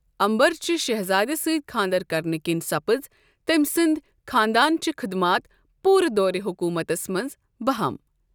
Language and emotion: Kashmiri, neutral